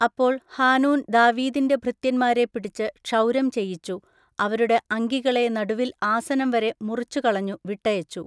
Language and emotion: Malayalam, neutral